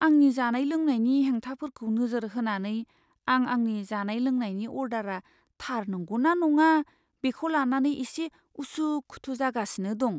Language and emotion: Bodo, fearful